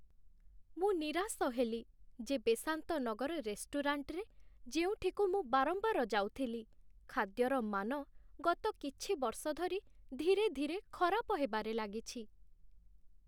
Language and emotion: Odia, sad